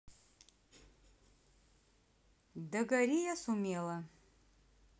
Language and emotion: Russian, neutral